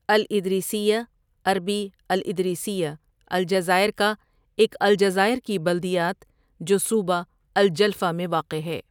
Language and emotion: Urdu, neutral